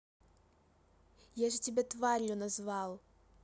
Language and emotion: Russian, angry